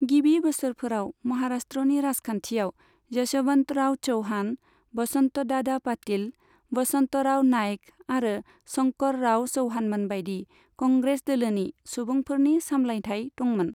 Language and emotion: Bodo, neutral